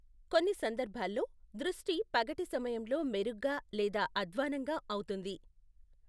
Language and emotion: Telugu, neutral